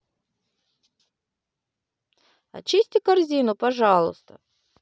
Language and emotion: Russian, positive